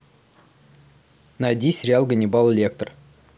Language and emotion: Russian, neutral